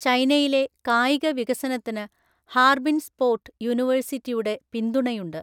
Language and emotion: Malayalam, neutral